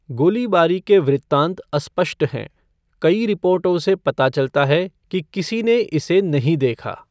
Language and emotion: Hindi, neutral